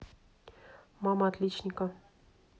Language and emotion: Russian, neutral